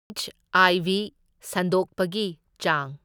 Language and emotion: Manipuri, neutral